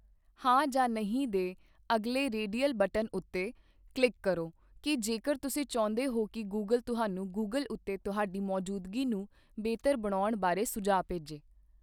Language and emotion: Punjabi, neutral